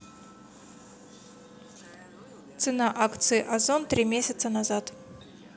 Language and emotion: Russian, neutral